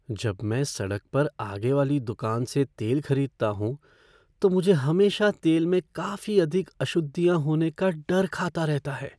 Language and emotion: Hindi, fearful